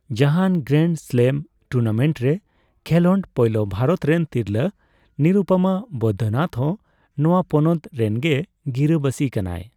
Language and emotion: Santali, neutral